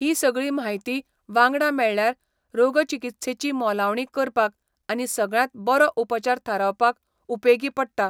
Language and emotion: Goan Konkani, neutral